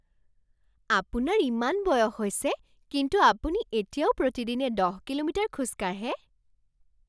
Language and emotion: Assamese, surprised